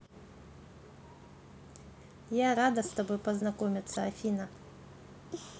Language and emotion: Russian, positive